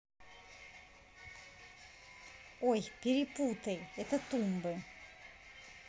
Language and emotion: Russian, neutral